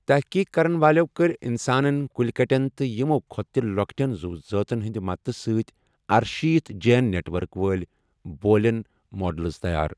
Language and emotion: Kashmiri, neutral